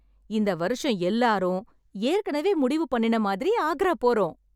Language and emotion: Tamil, happy